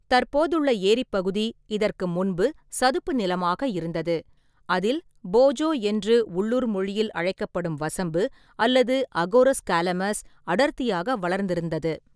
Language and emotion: Tamil, neutral